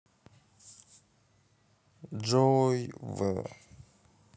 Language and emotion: Russian, sad